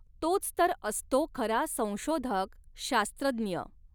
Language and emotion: Marathi, neutral